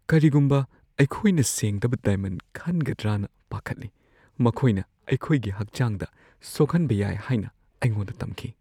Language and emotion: Manipuri, fearful